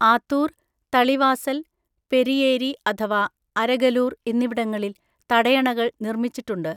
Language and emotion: Malayalam, neutral